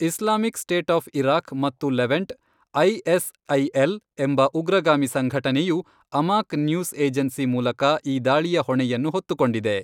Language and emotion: Kannada, neutral